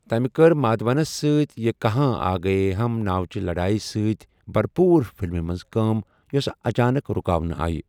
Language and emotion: Kashmiri, neutral